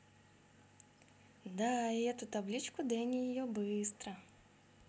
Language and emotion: Russian, neutral